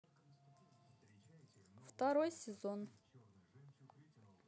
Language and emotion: Russian, neutral